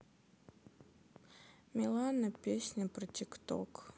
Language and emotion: Russian, sad